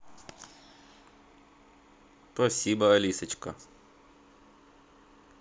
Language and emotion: Russian, positive